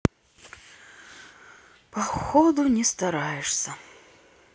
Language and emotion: Russian, sad